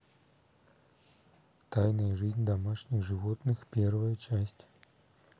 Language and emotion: Russian, neutral